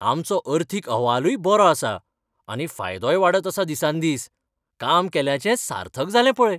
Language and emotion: Goan Konkani, happy